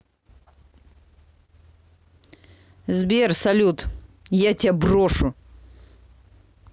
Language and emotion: Russian, angry